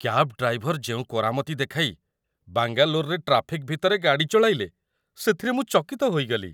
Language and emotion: Odia, surprised